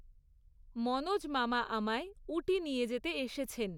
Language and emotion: Bengali, neutral